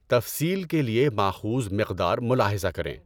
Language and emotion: Urdu, neutral